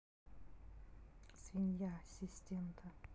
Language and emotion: Russian, neutral